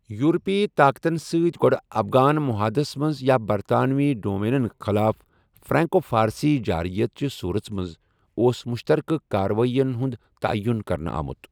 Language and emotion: Kashmiri, neutral